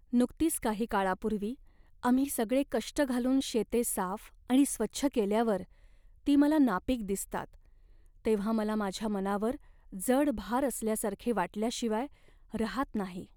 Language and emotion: Marathi, sad